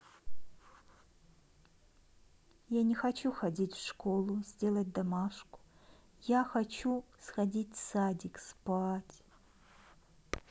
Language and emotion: Russian, sad